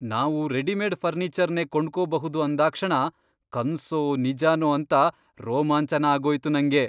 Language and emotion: Kannada, surprised